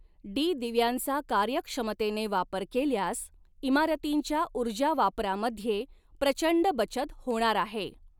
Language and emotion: Marathi, neutral